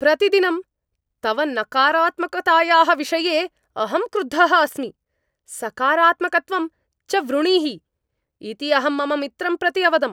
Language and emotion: Sanskrit, angry